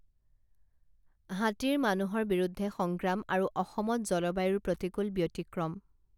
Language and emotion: Assamese, neutral